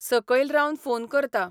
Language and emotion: Goan Konkani, neutral